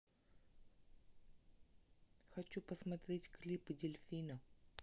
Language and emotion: Russian, neutral